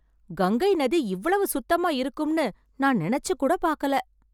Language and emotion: Tamil, surprised